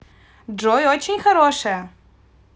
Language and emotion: Russian, positive